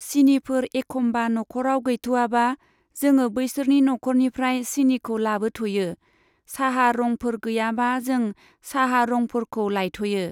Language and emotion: Bodo, neutral